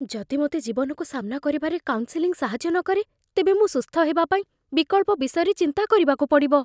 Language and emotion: Odia, fearful